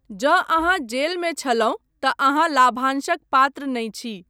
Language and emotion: Maithili, neutral